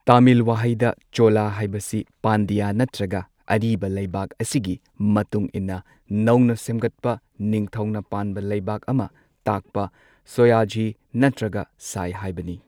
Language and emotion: Manipuri, neutral